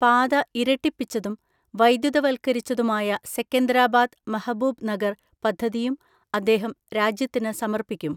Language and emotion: Malayalam, neutral